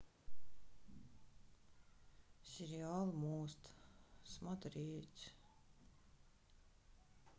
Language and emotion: Russian, sad